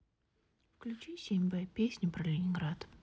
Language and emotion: Russian, neutral